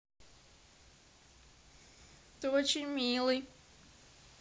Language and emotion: Russian, positive